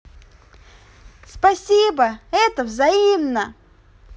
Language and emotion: Russian, positive